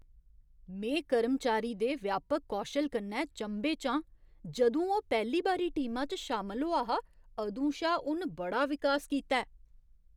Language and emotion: Dogri, surprised